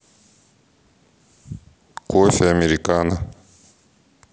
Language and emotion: Russian, neutral